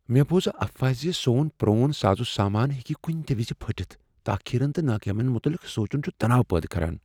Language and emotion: Kashmiri, fearful